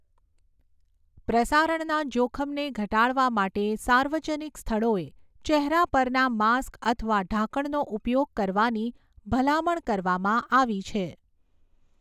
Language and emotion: Gujarati, neutral